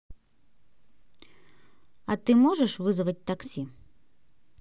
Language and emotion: Russian, neutral